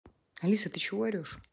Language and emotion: Russian, neutral